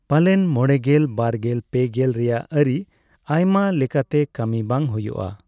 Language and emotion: Santali, neutral